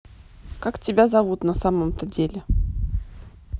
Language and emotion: Russian, neutral